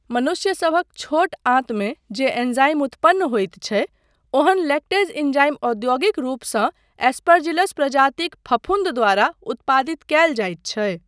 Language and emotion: Maithili, neutral